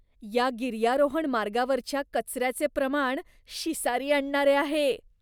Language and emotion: Marathi, disgusted